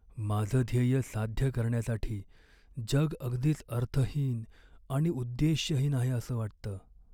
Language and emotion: Marathi, sad